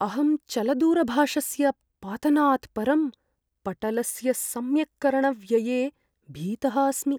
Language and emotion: Sanskrit, fearful